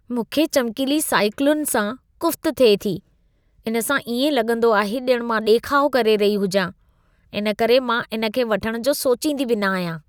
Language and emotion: Sindhi, disgusted